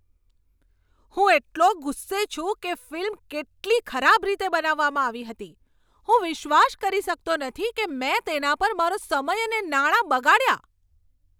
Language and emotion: Gujarati, angry